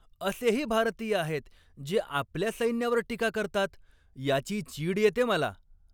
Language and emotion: Marathi, angry